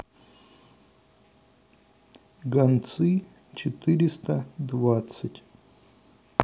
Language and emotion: Russian, neutral